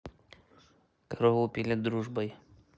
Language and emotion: Russian, neutral